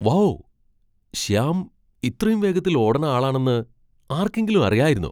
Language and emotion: Malayalam, surprised